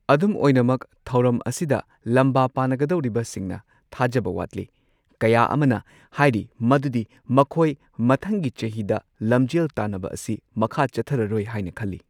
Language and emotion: Manipuri, neutral